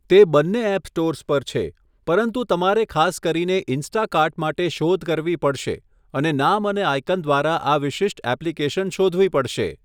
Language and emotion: Gujarati, neutral